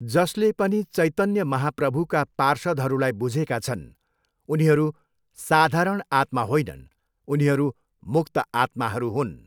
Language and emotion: Nepali, neutral